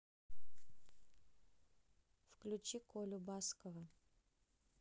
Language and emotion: Russian, neutral